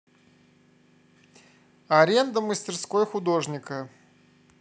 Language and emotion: Russian, neutral